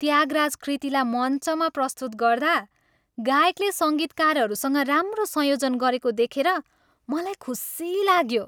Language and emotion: Nepali, happy